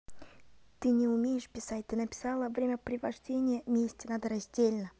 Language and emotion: Russian, neutral